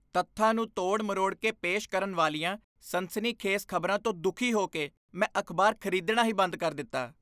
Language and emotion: Punjabi, disgusted